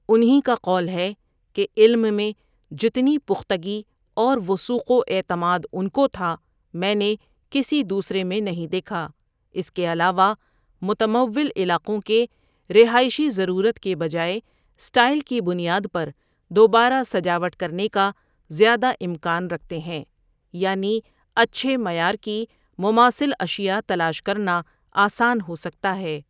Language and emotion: Urdu, neutral